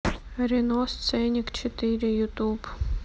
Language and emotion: Russian, neutral